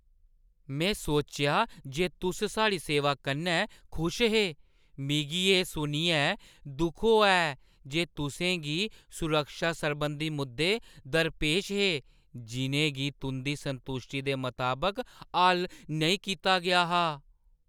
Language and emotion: Dogri, surprised